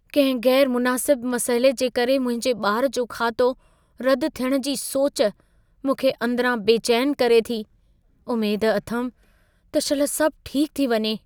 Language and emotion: Sindhi, fearful